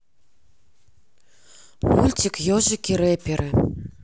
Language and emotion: Russian, neutral